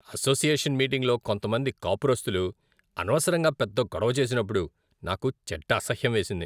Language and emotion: Telugu, disgusted